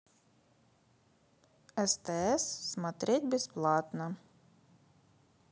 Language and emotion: Russian, neutral